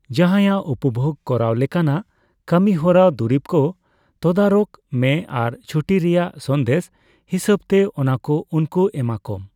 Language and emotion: Santali, neutral